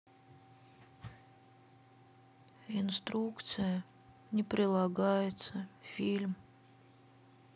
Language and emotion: Russian, sad